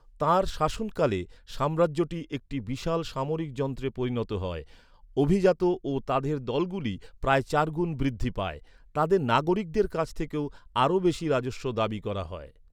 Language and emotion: Bengali, neutral